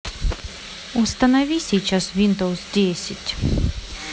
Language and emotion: Russian, neutral